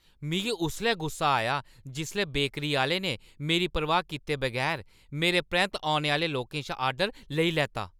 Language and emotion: Dogri, angry